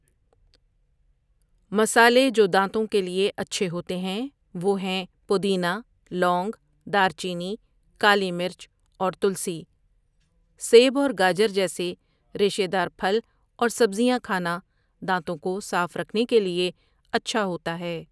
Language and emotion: Urdu, neutral